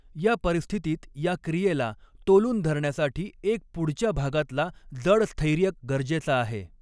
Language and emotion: Marathi, neutral